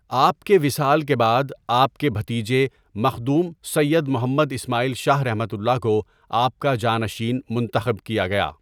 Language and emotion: Urdu, neutral